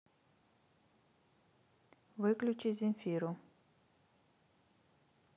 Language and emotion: Russian, neutral